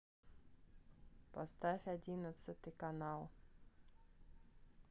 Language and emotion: Russian, neutral